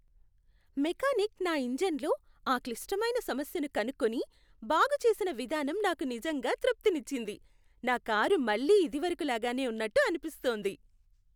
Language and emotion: Telugu, happy